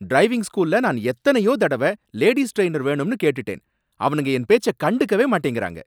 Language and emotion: Tamil, angry